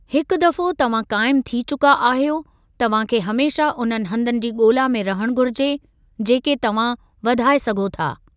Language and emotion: Sindhi, neutral